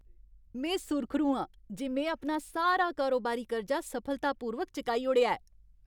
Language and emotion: Dogri, happy